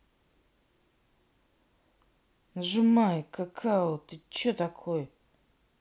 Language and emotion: Russian, angry